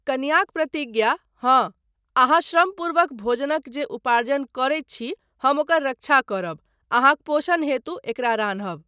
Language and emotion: Maithili, neutral